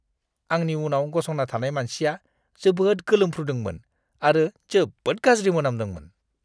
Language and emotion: Bodo, disgusted